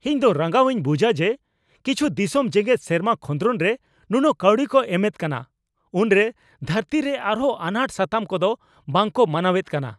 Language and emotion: Santali, angry